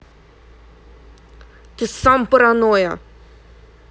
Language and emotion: Russian, angry